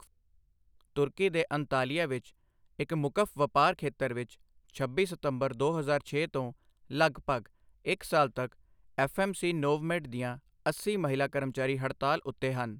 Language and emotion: Punjabi, neutral